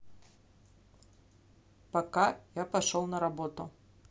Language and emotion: Russian, neutral